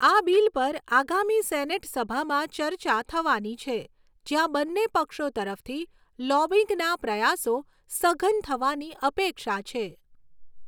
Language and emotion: Gujarati, neutral